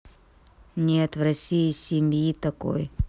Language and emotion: Russian, neutral